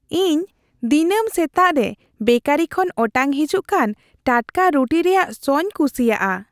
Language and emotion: Santali, happy